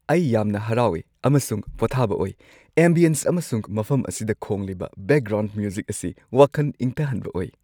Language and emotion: Manipuri, happy